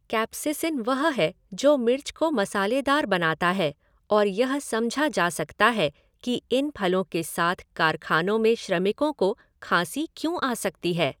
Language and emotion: Hindi, neutral